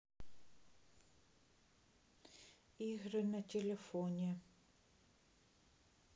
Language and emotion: Russian, neutral